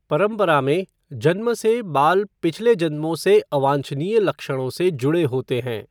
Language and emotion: Hindi, neutral